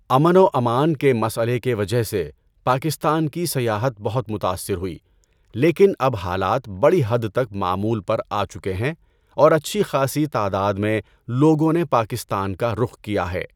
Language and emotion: Urdu, neutral